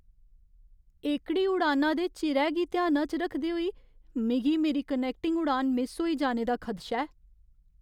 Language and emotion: Dogri, fearful